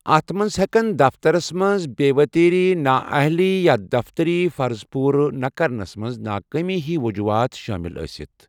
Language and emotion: Kashmiri, neutral